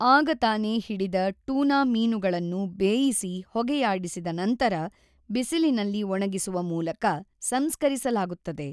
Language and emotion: Kannada, neutral